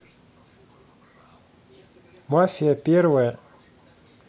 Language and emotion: Russian, neutral